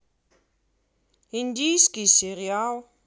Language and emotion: Russian, neutral